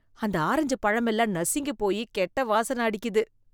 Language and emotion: Tamil, disgusted